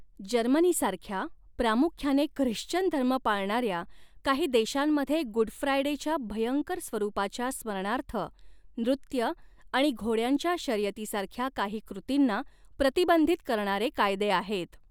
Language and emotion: Marathi, neutral